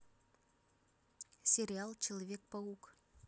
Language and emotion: Russian, neutral